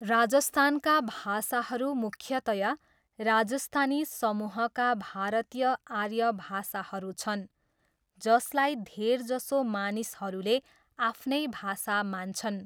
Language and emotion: Nepali, neutral